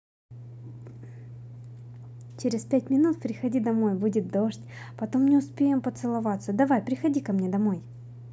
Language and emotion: Russian, positive